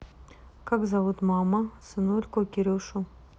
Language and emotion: Russian, neutral